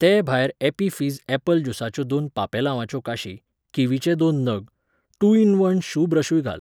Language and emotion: Goan Konkani, neutral